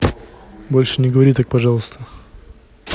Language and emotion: Russian, neutral